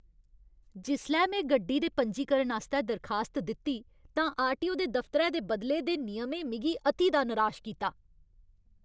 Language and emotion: Dogri, angry